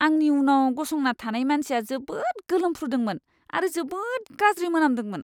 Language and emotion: Bodo, disgusted